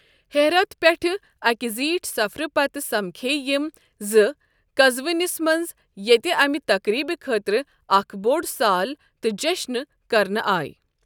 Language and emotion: Kashmiri, neutral